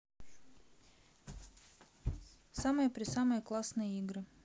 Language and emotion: Russian, neutral